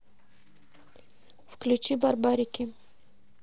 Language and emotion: Russian, neutral